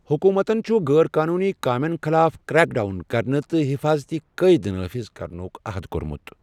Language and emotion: Kashmiri, neutral